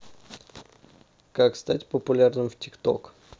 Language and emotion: Russian, neutral